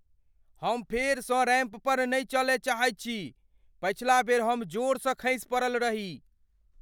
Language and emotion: Maithili, fearful